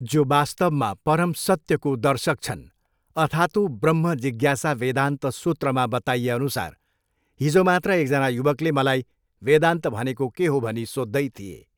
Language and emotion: Nepali, neutral